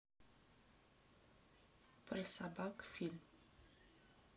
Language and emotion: Russian, neutral